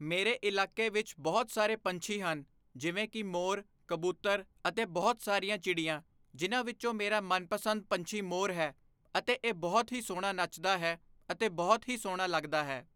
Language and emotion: Punjabi, neutral